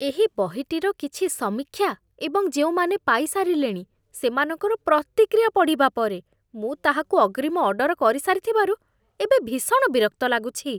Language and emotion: Odia, disgusted